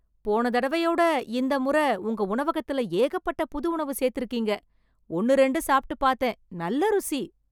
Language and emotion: Tamil, happy